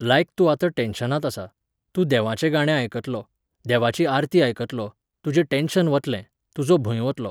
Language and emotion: Goan Konkani, neutral